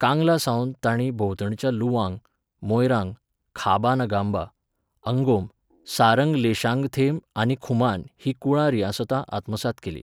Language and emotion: Goan Konkani, neutral